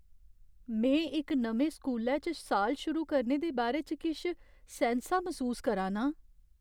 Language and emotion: Dogri, fearful